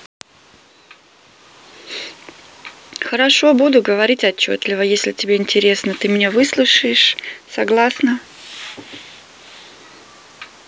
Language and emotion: Russian, neutral